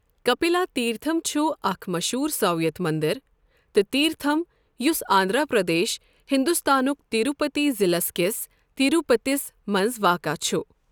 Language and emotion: Kashmiri, neutral